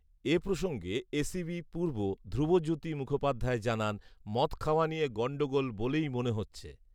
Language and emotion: Bengali, neutral